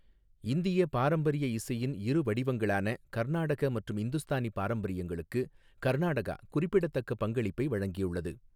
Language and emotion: Tamil, neutral